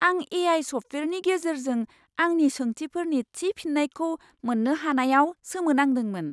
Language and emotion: Bodo, surprised